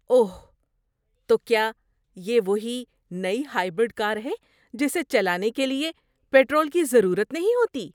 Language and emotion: Urdu, surprised